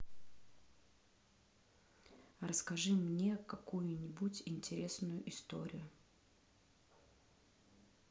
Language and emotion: Russian, neutral